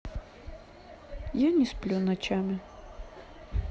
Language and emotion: Russian, sad